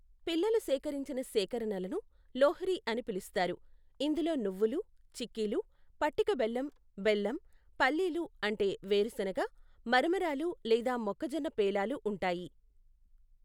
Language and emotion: Telugu, neutral